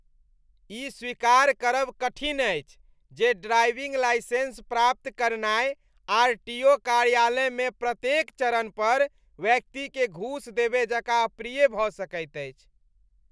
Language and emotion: Maithili, disgusted